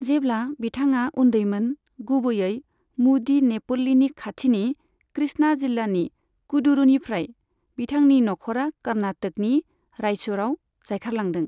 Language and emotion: Bodo, neutral